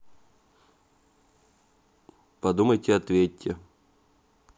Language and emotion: Russian, neutral